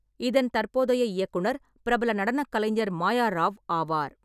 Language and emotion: Tamil, neutral